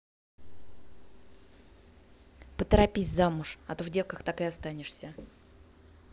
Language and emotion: Russian, neutral